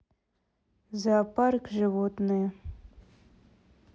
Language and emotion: Russian, neutral